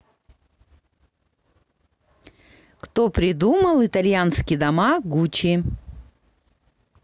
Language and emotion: Russian, positive